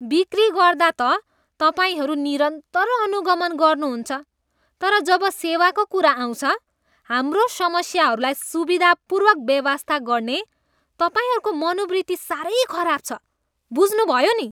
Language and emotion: Nepali, disgusted